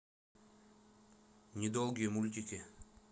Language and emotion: Russian, neutral